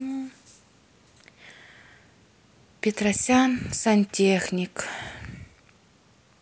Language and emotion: Russian, sad